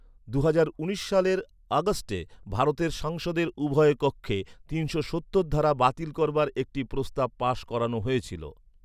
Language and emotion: Bengali, neutral